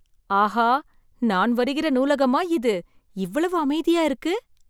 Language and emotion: Tamil, surprised